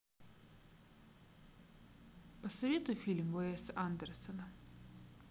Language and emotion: Russian, neutral